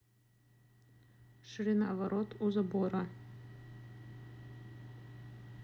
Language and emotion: Russian, neutral